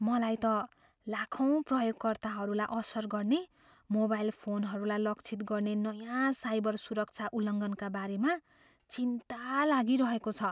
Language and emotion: Nepali, fearful